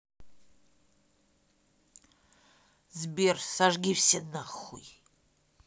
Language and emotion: Russian, angry